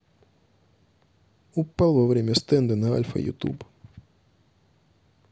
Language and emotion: Russian, neutral